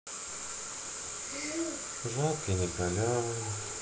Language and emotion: Russian, sad